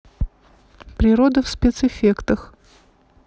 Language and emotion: Russian, neutral